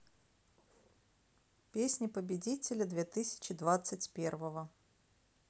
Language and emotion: Russian, neutral